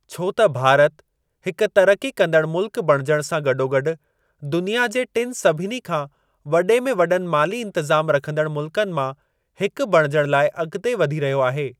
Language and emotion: Sindhi, neutral